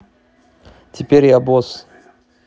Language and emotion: Russian, neutral